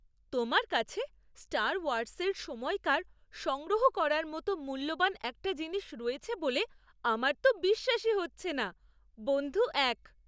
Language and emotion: Bengali, surprised